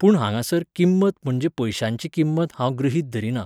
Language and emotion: Goan Konkani, neutral